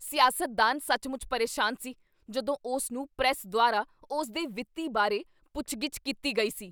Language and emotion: Punjabi, angry